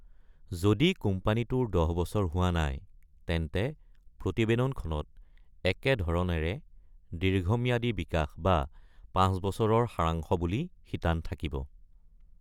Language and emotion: Assamese, neutral